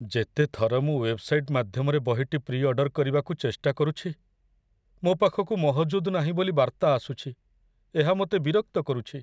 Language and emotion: Odia, sad